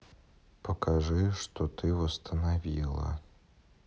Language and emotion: Russian, neutral